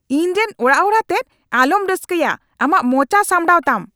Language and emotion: Santali, angry